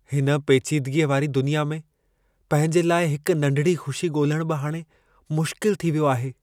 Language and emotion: Sindhi, sad